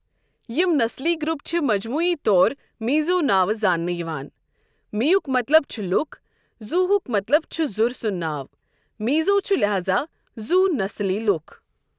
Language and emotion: Kashmiri, neutral